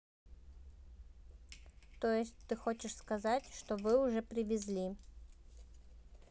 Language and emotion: Russian, neutral